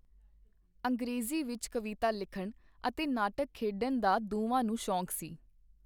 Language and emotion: Punjabi, neutral